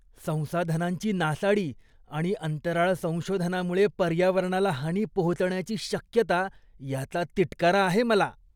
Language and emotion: Marathi, disgusted